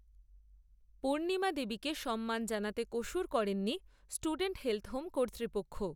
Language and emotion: Bengali, neutral